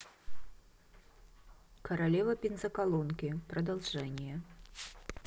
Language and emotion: Russian, neutral